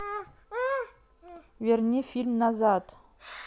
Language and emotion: Russian, neutral